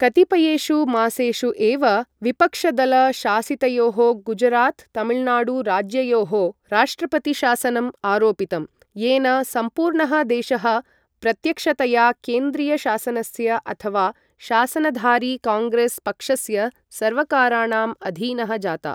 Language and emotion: Sanskrit, neutral